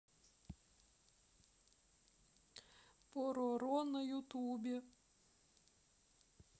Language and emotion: Russian, sad